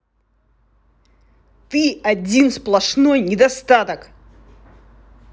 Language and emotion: Russian, angry